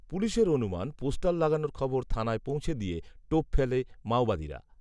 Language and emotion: Bengali, neutral